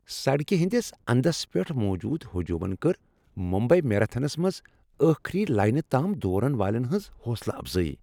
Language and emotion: Kashmiri, happy